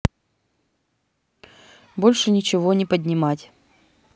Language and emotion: Russian, neutral